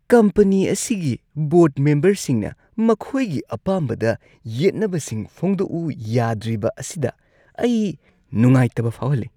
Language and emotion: Manipuri, disgusted